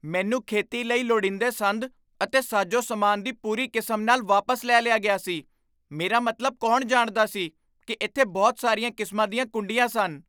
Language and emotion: Punjabi, surprised